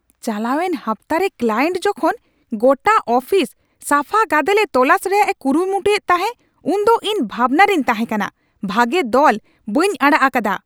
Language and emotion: Santali, angry